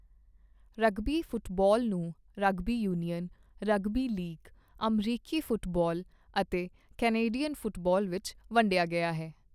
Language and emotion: Punjabi, neutral